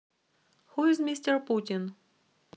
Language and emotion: Russian, neutral